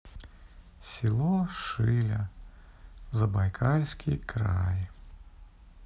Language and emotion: Russian, sad